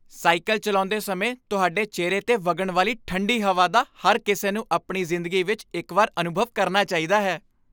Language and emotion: Punjabi, happy